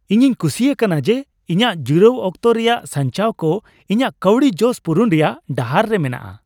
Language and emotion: Santali, happy